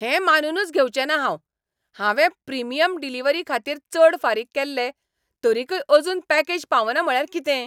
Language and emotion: Goan Konkani, angry